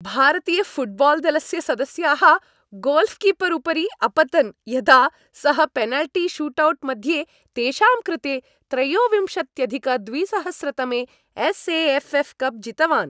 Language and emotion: Sanskrit, happy